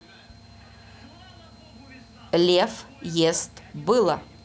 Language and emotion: Russian, neutral